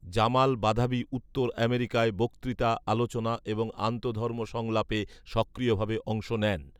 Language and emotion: Bengali, neutral